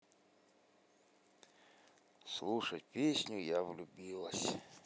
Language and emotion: Russian, sad